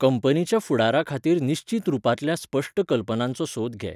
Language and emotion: Goan Konkani, neutral